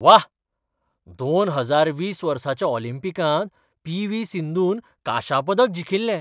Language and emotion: Goan Konkani, surprised